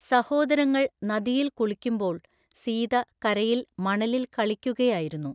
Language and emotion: Malayalam, neutral